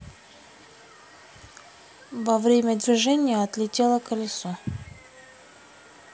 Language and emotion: Russian, neutral